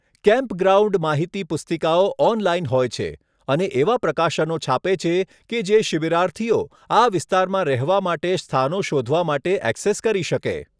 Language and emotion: Gujarati, neutral